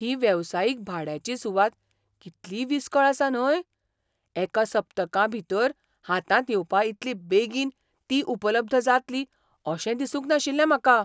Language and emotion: Goan Konkani, surprised